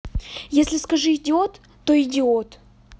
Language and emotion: Russian, angry